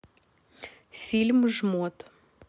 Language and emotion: Russian, neutral